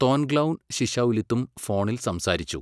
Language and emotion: Malayalam, neutral